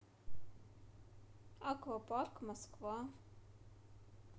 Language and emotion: Russian, neutral